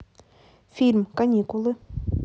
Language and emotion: Russian, neutral